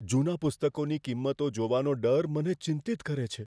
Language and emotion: Gujarati, fearful